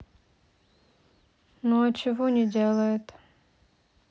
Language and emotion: Russian, neutral